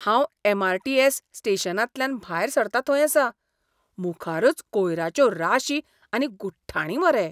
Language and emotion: Goan Konkani, disgusted